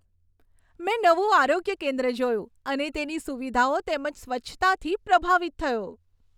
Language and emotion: Gujarati, happy